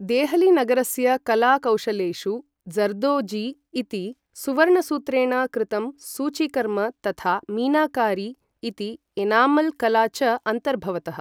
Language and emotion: Sanskrit, neutral